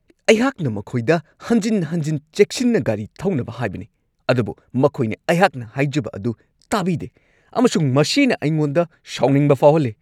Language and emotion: Manipuri, angry